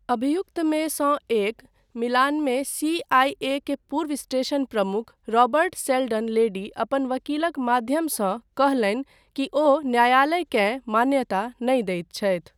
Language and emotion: Maithili, neutral